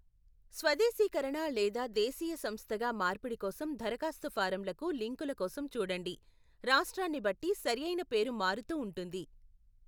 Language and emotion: Telugu, neutral